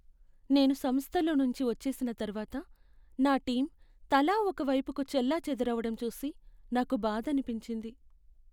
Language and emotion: Telugu, sad